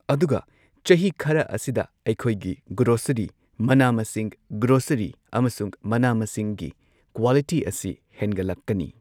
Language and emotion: Manipuri, neutral